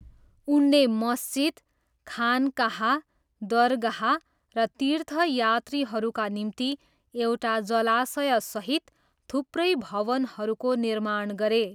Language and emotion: Nepali, neutral